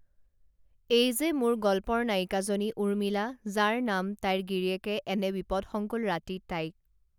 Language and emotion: Assamese, neutral